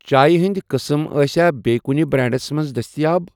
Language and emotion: Kashmiri, neutral